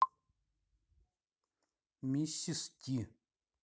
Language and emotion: Russian, neutral